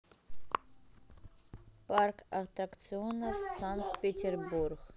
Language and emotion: Russian, neutral